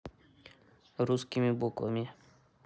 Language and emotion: Russian, neutral